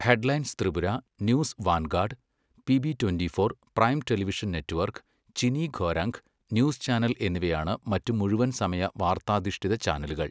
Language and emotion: Malayalam, neutral